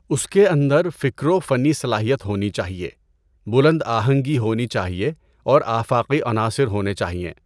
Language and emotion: Urdu, neutral